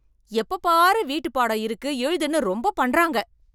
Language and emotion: Tamil, angry